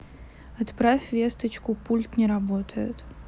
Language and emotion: Russian, neutral